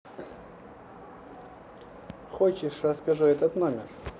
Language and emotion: Russian, neutral